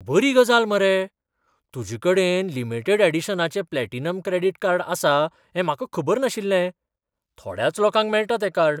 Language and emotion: Goan Konkani, surprised